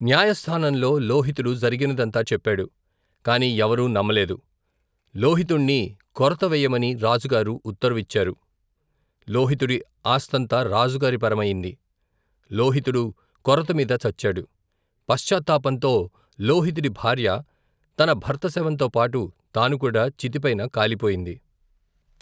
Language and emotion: Telugu, neutral